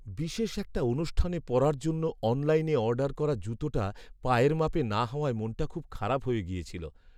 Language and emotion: Bengali, sad